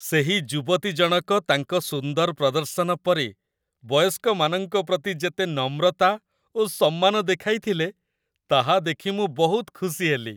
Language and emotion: Odia, happy